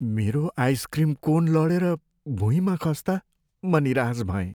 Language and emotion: Nepali, sad